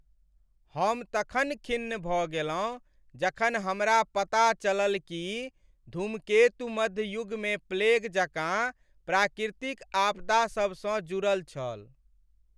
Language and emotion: Maithili, sad